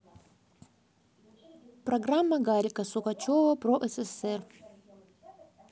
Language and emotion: Russian, neutral